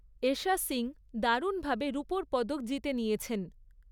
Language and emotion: Bengali, neutral